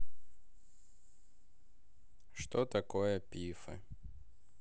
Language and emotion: Russian, sad